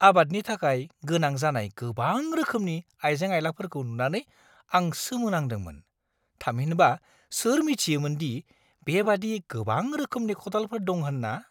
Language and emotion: Bodo, surprised